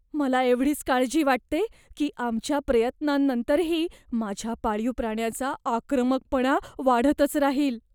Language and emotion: Marathi, fearful